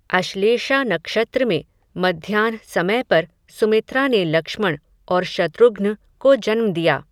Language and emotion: Hindi, neutral